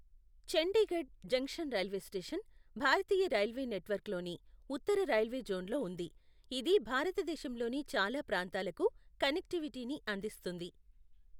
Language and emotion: Telugu, neutral